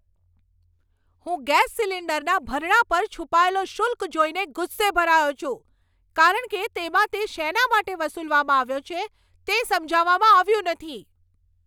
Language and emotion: Gujarati, angry